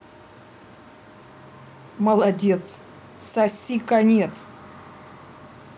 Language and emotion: Russian, angry